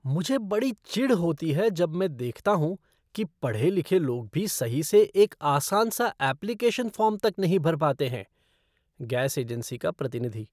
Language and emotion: Hindi, disgusted